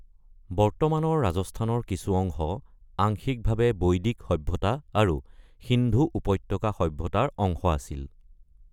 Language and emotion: Assamese, neutral